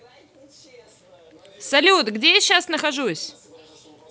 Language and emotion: Russian, positive